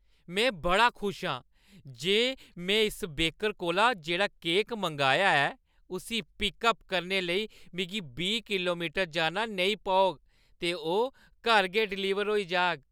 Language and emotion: Dogri, happy